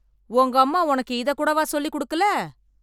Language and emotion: Tamil, angry